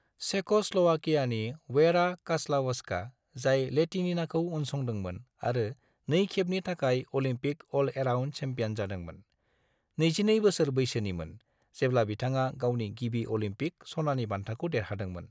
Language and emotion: Bodo, neutral